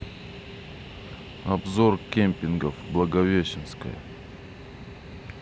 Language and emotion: Russian, neutral